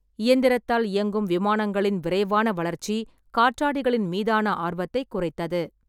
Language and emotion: Tamil, neutral